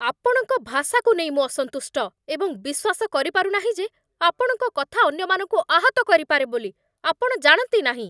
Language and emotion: Odia, angry